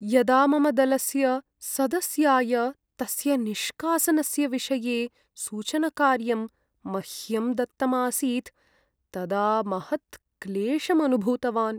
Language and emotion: Sanskrit, sad